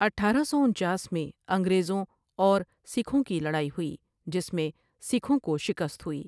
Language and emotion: Urdu, neutral